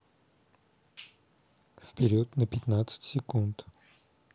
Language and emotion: Russian, neutral